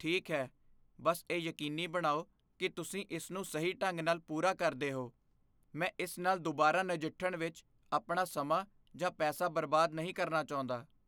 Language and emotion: Punjabi, fearful